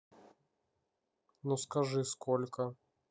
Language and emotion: Russian, neutral